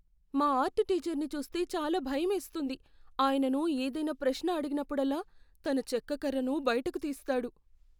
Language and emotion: Telugu, fearful